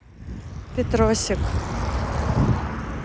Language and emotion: Russian, neutral